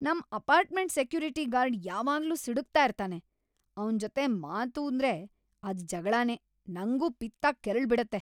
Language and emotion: Kannada, angry